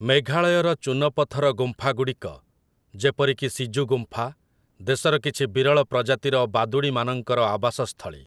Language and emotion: Odia, neutral